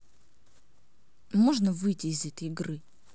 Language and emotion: Russian, angry